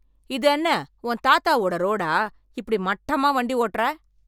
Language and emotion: Tamil, angry